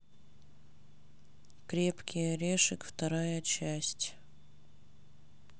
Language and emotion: Russian, neutral